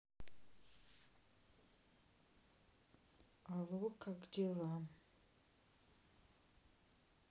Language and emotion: Russian, sad